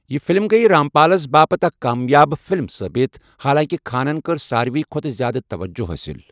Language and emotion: Kashmiri, neutral